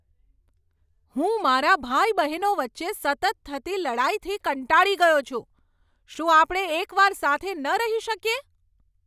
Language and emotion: Gujarati, angry